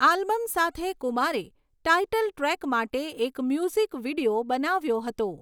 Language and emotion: Gujarati, neutral